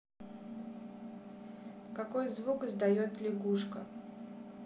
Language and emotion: Russian, neutral